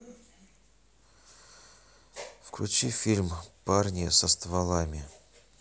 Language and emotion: Russian, sad